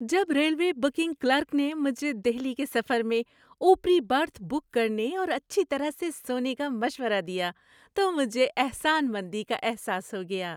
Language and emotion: Urdu, happy